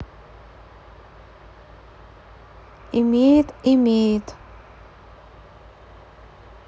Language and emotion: Russian, neutral